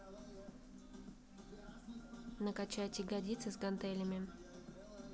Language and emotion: Russian, neutral